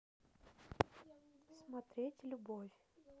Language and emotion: Russian, neutral